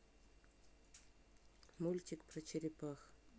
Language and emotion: Russian, neutral